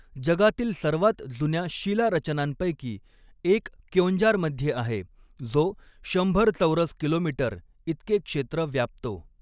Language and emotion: Marathi, neutral